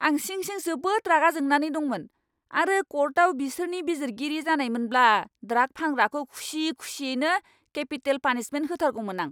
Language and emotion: Bodo, angry